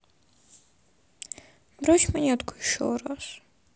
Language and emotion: Russian, sad